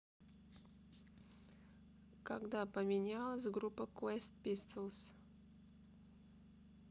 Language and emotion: Russian, neutral